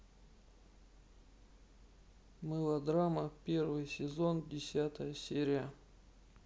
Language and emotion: Russian, neutral